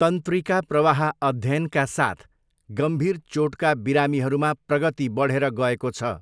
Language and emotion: Nepali, neutral